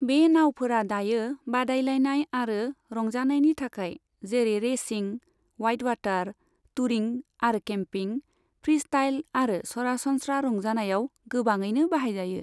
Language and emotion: Bodo, neutral